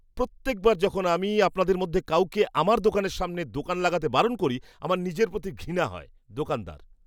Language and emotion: Bengali, disgusted